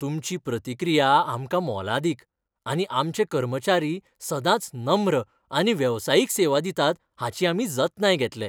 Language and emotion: Goan Konkani, happy